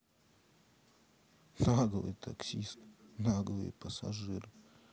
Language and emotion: Russian, angry